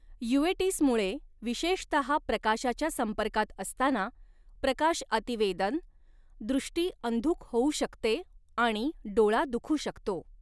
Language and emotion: Marathi, neutral